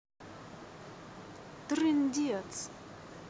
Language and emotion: Russian, neutral